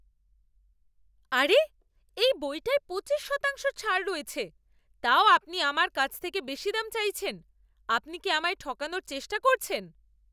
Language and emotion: Bengali, angry